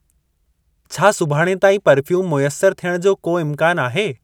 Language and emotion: Sindhi, neutral